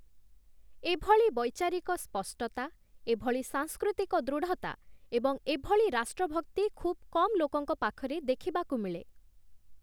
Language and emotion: Odia, neutral